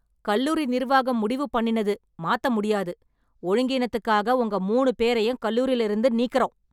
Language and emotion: Tamil, angry